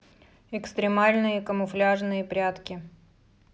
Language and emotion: Russian, neutral